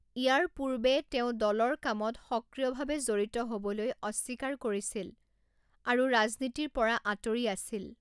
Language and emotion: Assamese, neutral